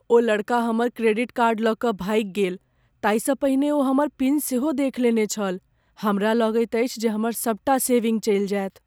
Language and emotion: Maithili, fearful